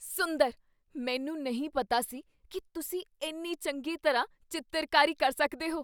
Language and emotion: Punjabi, surprised